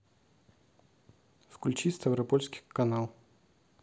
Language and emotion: Russian, neutral